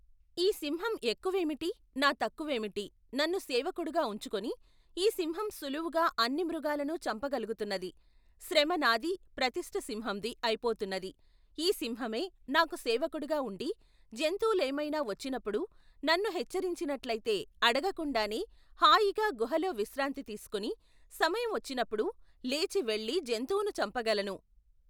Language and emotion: Telugu, neutral